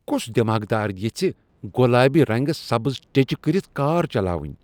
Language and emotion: Kashmiri, disgusted